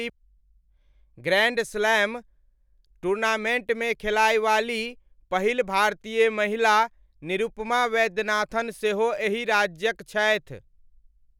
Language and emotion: Maithili, neutral